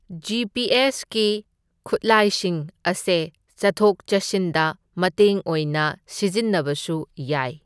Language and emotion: Manipuri, neutral